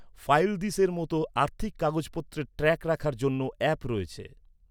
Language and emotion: Bengali, neutral